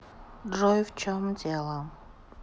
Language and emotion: Russian, sad